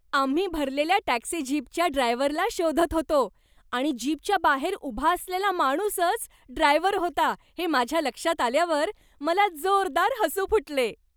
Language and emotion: Marathi, happy